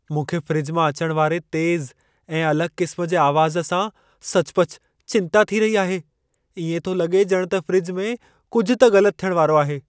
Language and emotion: Sindhi, fearful